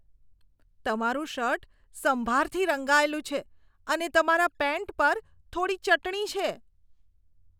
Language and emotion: Gujarati, disgusted